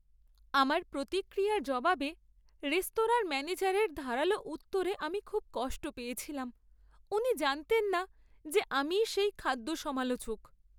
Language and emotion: Bengali, sad